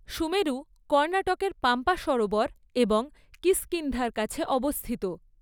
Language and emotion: Bengali, neutral